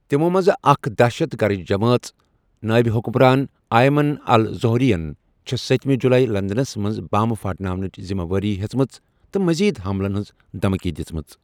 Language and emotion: Kashmiri, neutral